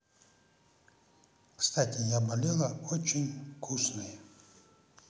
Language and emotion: Russian, positive